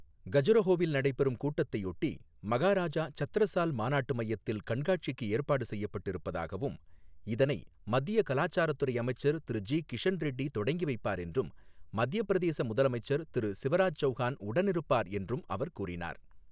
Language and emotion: Tamil, neutral